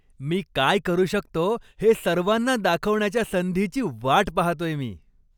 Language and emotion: Marathi, happy